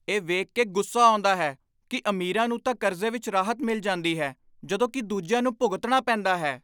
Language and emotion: Punjabi, angry